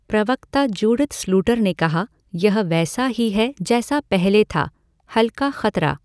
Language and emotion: Hindi, neutral